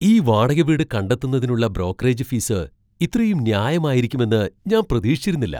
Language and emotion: Malayalam, surprised